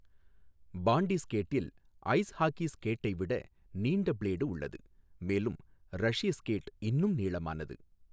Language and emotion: Tamil, neutral